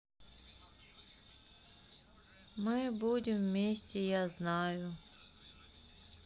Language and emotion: Russian, sad